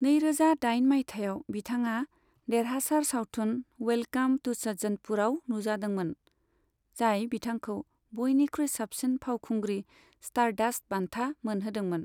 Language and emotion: Bodo, neutral